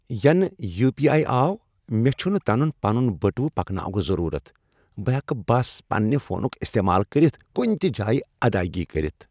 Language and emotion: Kashmiri, happy